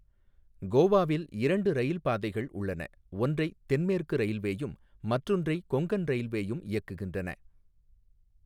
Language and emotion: Tamil, neutral